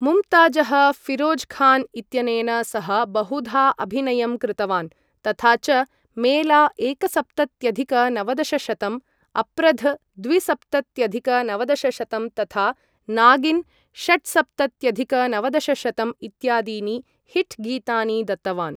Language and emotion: Sanskrit, neutral